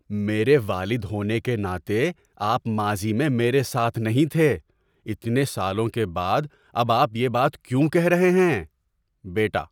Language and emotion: Urdu, surprised